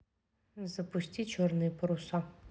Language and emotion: Russian, neutral